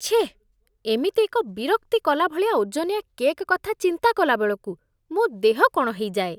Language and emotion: Odia, disgusted